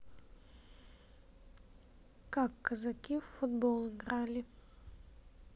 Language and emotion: Russian, neutral